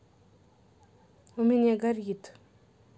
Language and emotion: Russian, neutral